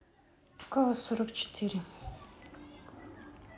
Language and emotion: Russian, sad